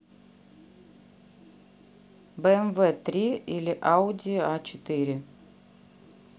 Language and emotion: Russian, neutral